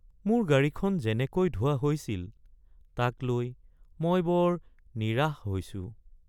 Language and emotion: Assamese, sad